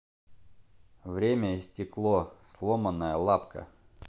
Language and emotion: Russian, neutral